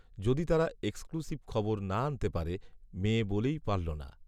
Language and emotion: Bengali, neutral